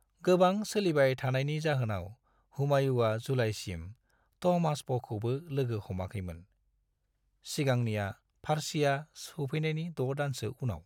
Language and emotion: Bodo, neutral